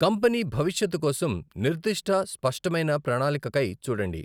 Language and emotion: Telugu, neutral